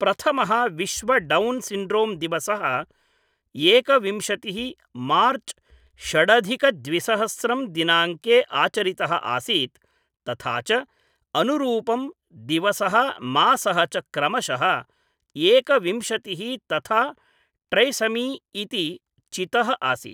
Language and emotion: Sanskrit, neutral